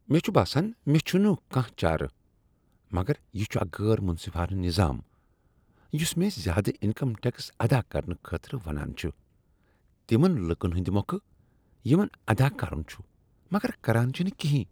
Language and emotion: Kashmiri, disgusted